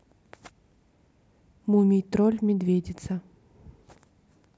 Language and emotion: Russian, neutral